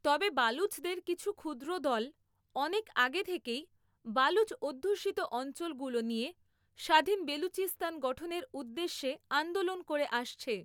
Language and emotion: Bengali, neutral